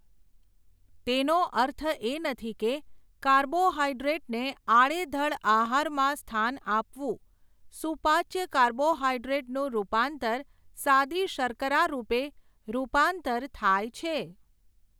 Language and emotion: Gujarati, neutral